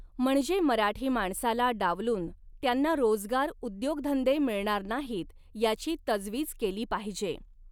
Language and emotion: Marathi, neutral